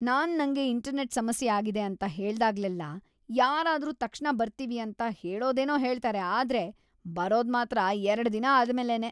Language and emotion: Kannada, disgusted